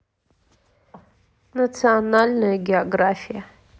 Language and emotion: Russian, neutral